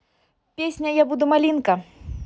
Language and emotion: Russian, positive